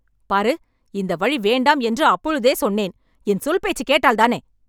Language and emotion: Tamil, angry